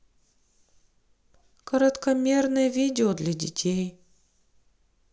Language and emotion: Russian, sad